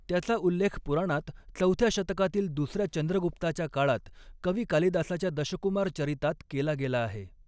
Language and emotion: Marathi, neutral